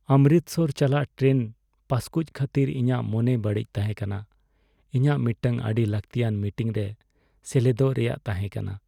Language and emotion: Santali, sad